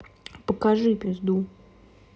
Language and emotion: Russian, neutral